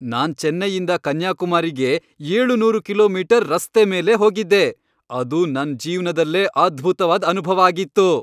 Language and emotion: Kannada, happy